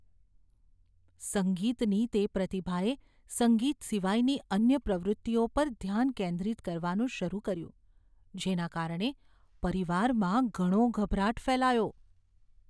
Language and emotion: Gujarati, fearful